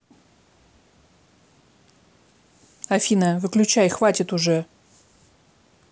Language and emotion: Russian, angry